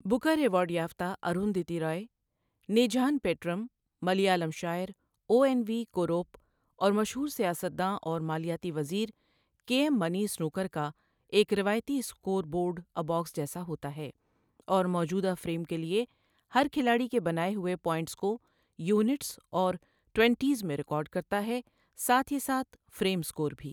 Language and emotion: Urdu, neutral